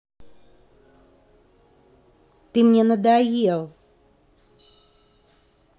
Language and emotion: Russian, angry